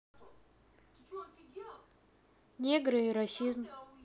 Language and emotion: Russian, neutral